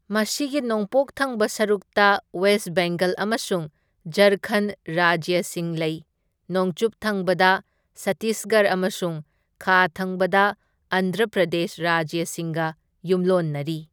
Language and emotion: Manipuri, neutral